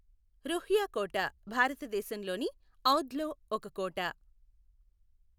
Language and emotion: Telugu, neutral